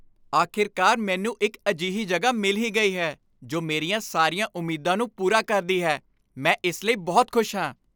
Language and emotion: Punjabi, happy